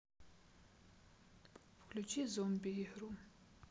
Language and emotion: Russian, sad